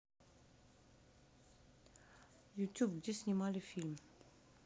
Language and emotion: Russian, neutral